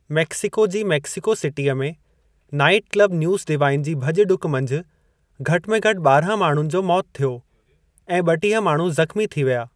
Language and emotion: Sindhi, neutral